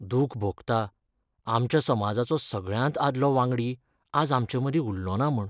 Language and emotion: Goan Konkani, sad